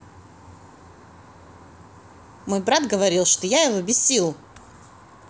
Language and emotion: Russian, positive